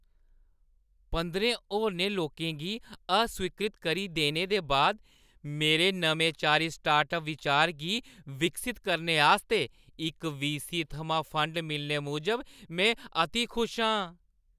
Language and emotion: Dogri, happy